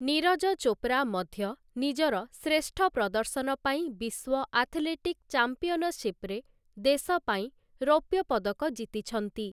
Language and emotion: Odia, neutral